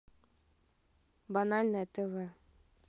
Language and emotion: Russian, neutral